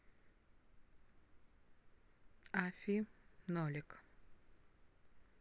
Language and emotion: Russian, neutral